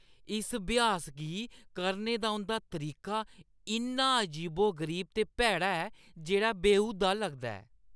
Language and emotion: Dogri, disgusted